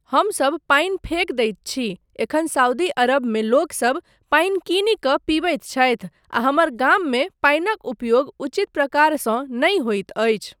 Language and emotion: Maithili, neutral